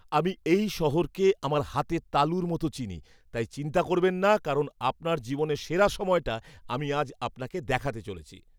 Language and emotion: Bengali, happy